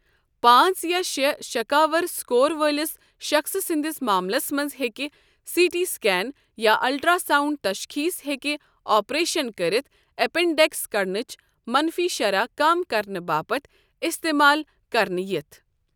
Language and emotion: Kashmiri, neutral